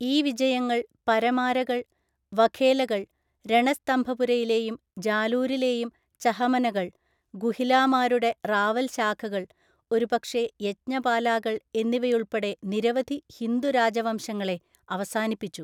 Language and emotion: Malayalam, neutral